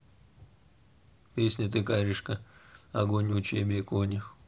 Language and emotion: Russian, neutral